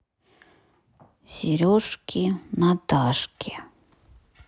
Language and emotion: Russian, neutral